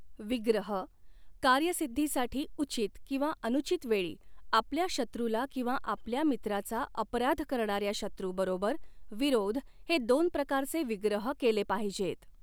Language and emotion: Marathi, neutral